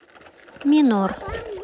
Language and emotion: Russian, neutral